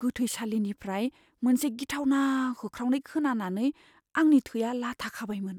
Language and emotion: Bodo, fearful